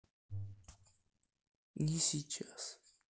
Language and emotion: Russian, neutral